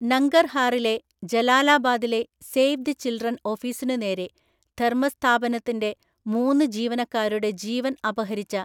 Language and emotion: Malayalam, neutral